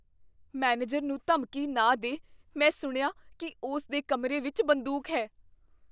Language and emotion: Punjabi, fearful